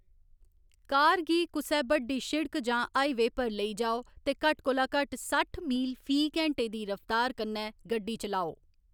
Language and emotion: Dogri, neutral